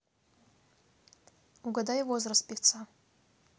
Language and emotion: Russian, neutral